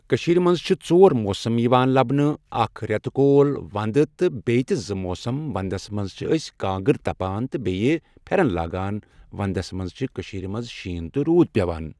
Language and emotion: Kashmiri, neutral